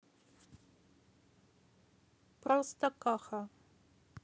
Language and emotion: Russian, neutral